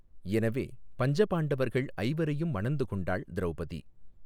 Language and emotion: Tamil, neutral